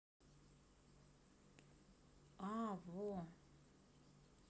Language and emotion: Russian, neutral